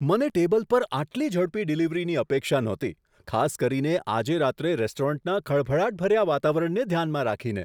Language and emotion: Gujarati, surprised